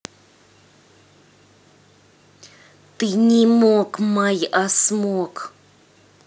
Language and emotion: Russian, angry